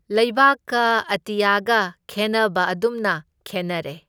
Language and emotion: Manipuri, neutral